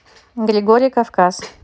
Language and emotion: Russian, neutral